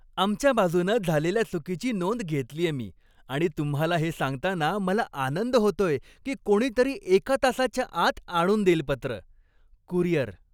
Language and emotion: Marathi, happy